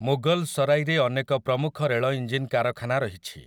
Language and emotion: Odia, neutral